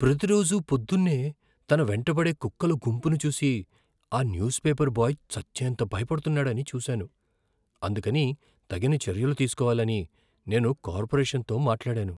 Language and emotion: Telugu, fearful